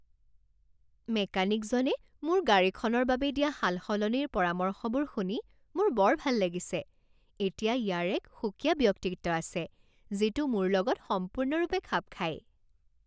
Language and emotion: Assamese, happy